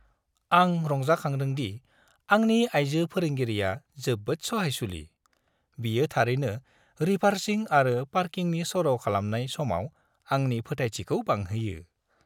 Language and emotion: Bodo, happy